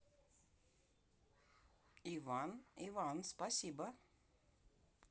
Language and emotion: Russian, neutral